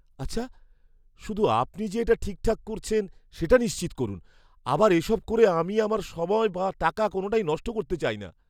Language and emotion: Bengali, fearful